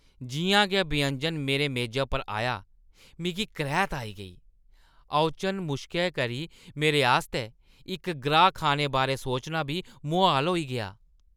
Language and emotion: Dogri, disgusted